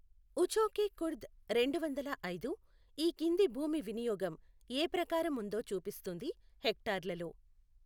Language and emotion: Telugu, neutral